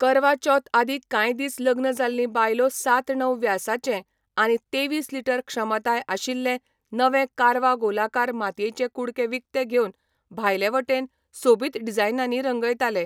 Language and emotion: Goan Konkani, neutral